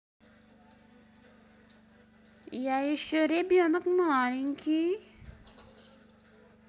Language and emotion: Russian, neutral